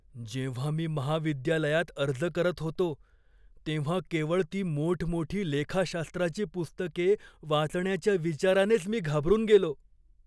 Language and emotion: Marathi, fearful